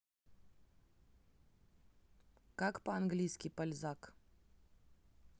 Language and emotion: Russian, neutral